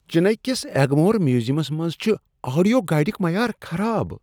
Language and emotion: Kashmiri, disgusted